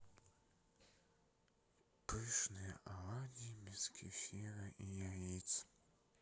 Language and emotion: Russian, neutral